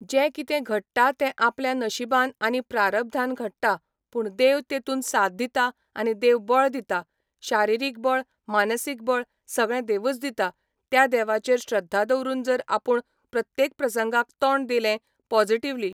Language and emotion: Goan Konkani, neutral